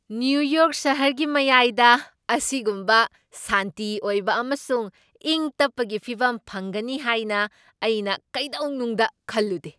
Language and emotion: Manipuri, surprised